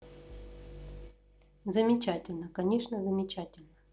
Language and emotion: Russian, neutral